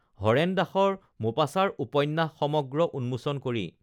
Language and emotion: Assamese, neutral